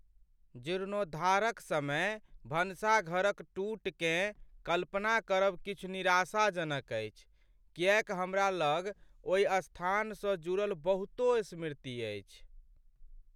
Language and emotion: Maithili, sad